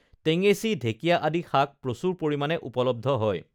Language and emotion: Assamese, neutral